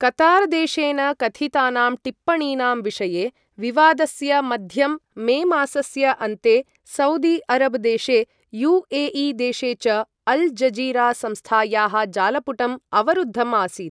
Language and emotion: Sanskrit, neutral